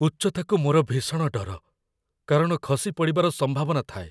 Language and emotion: Odia, fearful